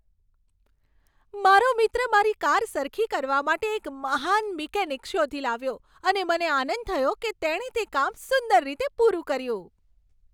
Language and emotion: Gujarati, happy